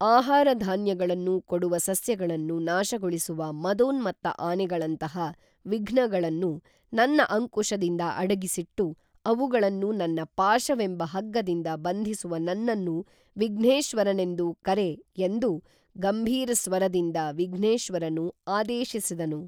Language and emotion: Kannada, neutral